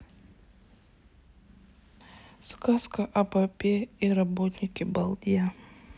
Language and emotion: Russian, sad